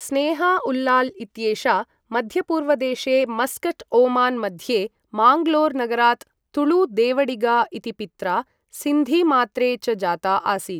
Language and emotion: Sanskrit, neutral